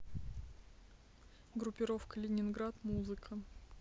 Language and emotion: Russian, neutral